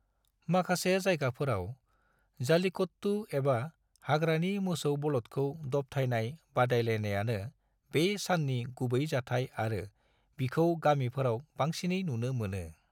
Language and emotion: Bodo, neutral